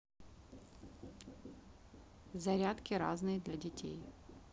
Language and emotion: Russian, neutral